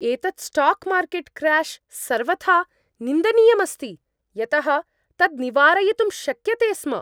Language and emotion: Sanskrit, angry